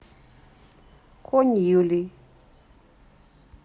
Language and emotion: Russian, neutral